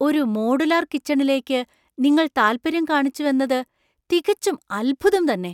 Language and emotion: Malayalam, surprised